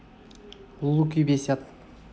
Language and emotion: Russian, neutral